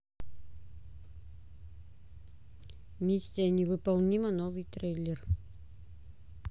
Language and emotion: Russian, neutral